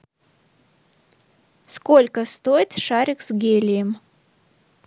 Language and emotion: Russian, neutral